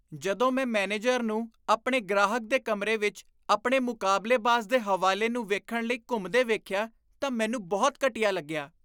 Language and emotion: Punjabi, disgusted